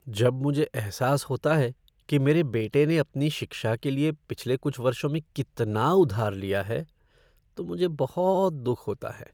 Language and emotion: Hindi, sad